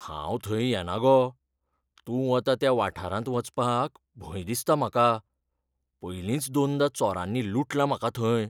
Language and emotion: Goan Konkani, fearful